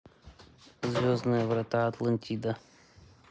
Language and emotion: Russian, neutral